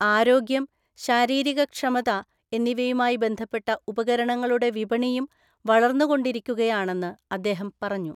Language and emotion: Malayalam, neutral